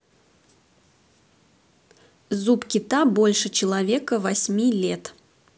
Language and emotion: Russian, neutral